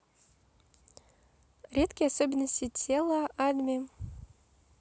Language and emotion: Russian, neutral